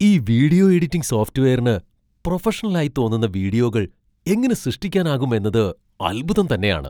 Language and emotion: Malayalam, surprised